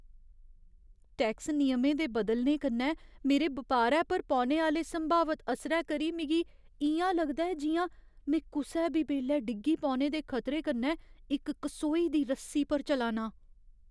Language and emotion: Dogri, fearful